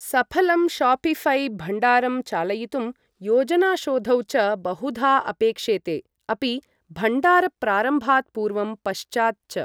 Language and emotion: Sanskrit, neutral